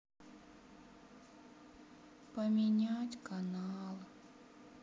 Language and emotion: Russian, sad